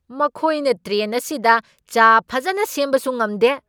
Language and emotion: Manipuri, angry